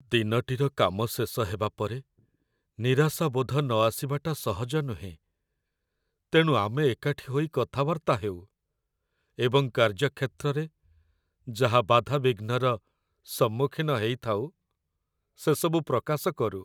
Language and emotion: Odia, sad